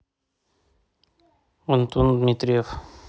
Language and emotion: Russian, neutral